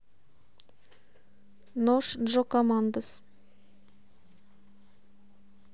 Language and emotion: Russian, neutral